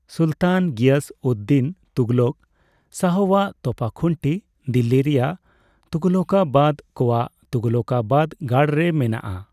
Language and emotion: Santali, neutral